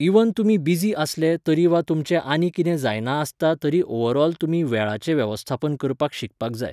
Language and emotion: Goan Konkani, neutral